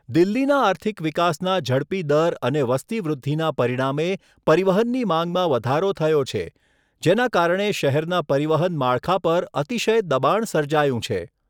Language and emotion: Gujarati, neutral